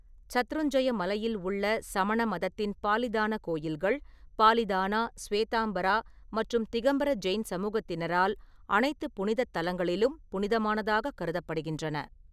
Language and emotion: Tamil, neutral